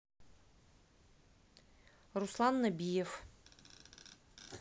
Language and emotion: Russian, neutral